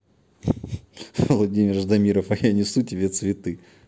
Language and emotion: Russian, positive